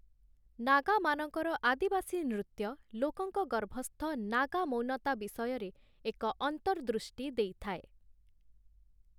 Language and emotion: Odia, neutral